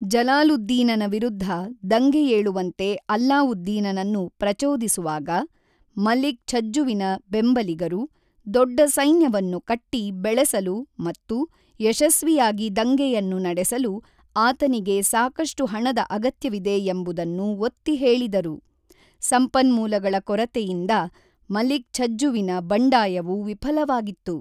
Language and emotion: Kannada, neutral